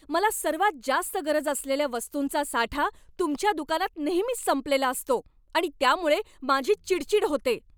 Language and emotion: Marathi, angry